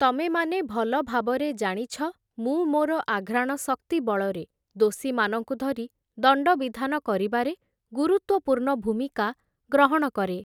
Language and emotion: Odia, neutral